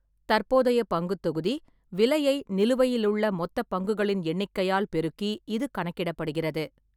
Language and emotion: Tamil, neutral